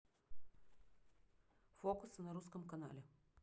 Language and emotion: Russian, neutral